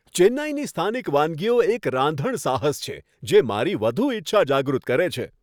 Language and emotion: Gujarati, happy